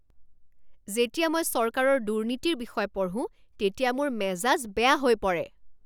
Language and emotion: Assamese, angry